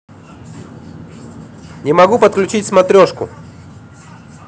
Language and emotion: Russian, neutral